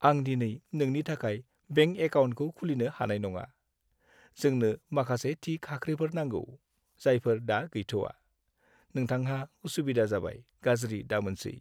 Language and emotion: Bodo, sad